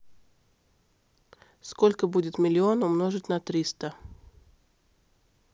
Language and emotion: Russian, neutral